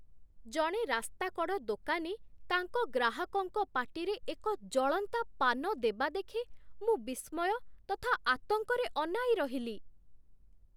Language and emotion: Odia, surprised